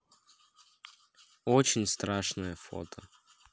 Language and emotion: Russian, neutral